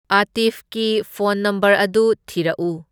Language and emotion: Manipuri, neutral